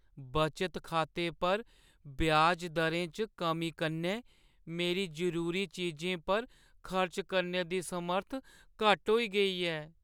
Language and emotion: Dogri, sad